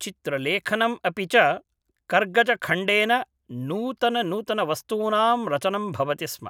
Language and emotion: Sanskrit, neutral